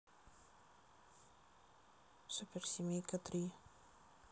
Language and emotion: Russian, neutral